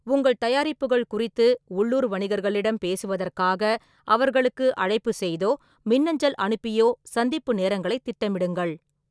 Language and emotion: Tamil, neutral